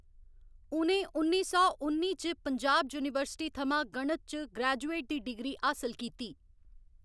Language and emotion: Dogri, neutral